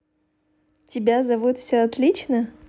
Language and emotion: Russian, positive